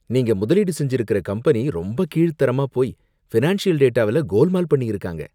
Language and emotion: Tamil, disgusted